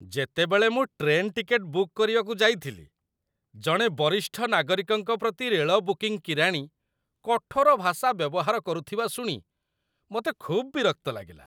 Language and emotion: Odia, disgusted